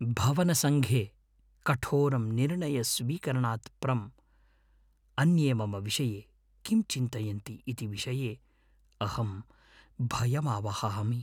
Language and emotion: Sanskrit, fearful